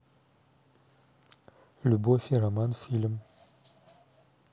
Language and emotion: Russian, neutral